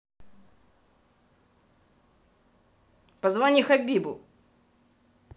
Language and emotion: Russian, angry